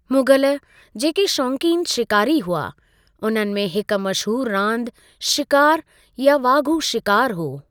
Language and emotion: Sindhi, neutral